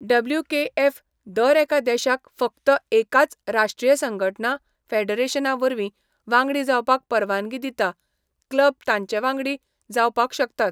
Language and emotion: Goan Konkani, neutral